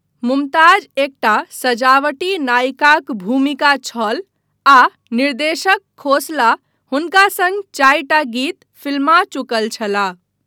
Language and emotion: Maithili, neutral